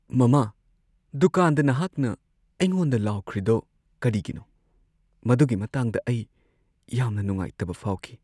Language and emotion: Manipuri, sad